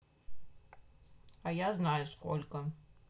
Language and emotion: Russian, neutral